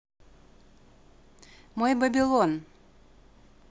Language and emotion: Russian, neutral